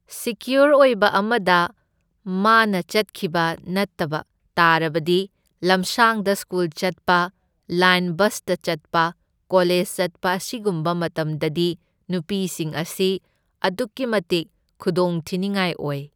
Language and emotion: Manipuri, neutral